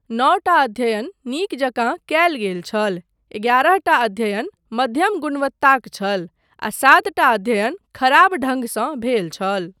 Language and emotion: Maithili, neutral